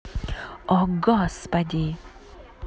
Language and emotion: Russian, angry